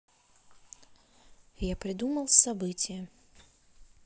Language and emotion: Russian, neutral